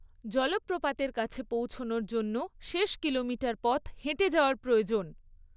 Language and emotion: Bengali, neutral